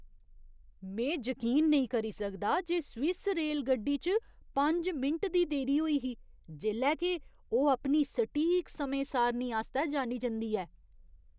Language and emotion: Dogri, surprised